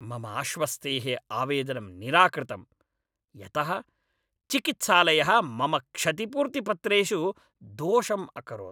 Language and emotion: Sanskrit, angry